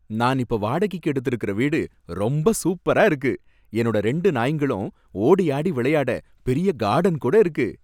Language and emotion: Tamil, happy